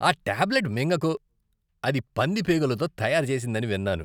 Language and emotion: Telugu, disgusted